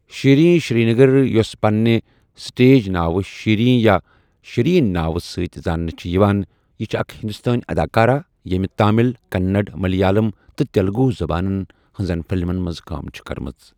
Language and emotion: Kashmiri, neutral